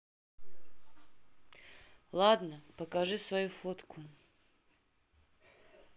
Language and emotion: Russian, neutral